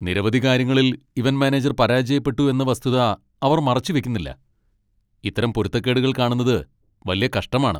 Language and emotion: Malayalam, angry